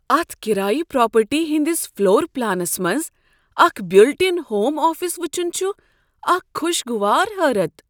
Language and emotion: Kashmiri, surprised